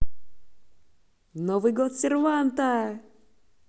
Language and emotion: Russian, positive